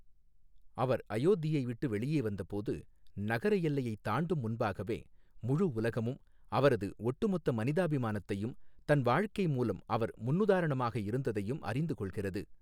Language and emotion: Tamil, neutral